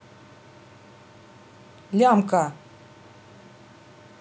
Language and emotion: Russian, neutral